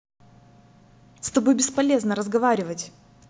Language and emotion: Russian, angry